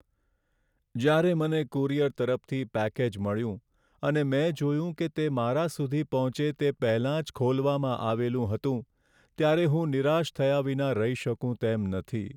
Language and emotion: Gujarati, sad